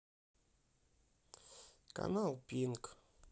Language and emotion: Russian, sad